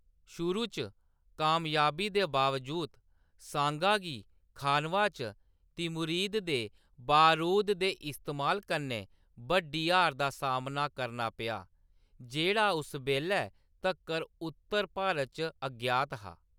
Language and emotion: Dogri, neutral